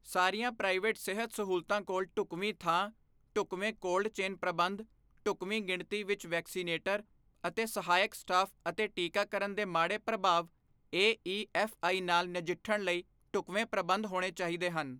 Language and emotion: Punjabi, neutral